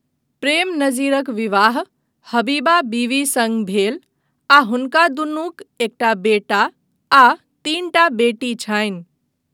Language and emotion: Maithili, neutral